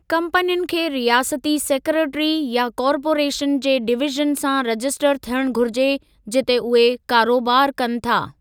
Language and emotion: Sindhi, neutral